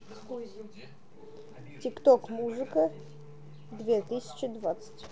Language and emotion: Russian, neutral